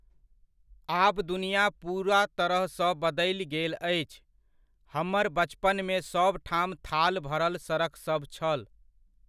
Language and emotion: Maithili, neutral